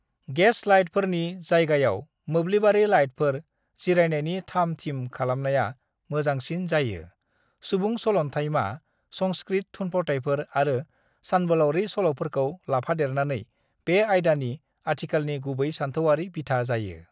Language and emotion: Bodo, neutral